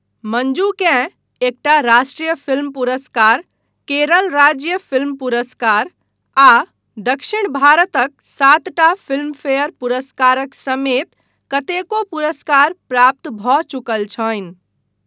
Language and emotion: Maithili, neutral